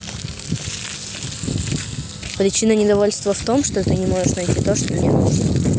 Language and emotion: Russian, neutral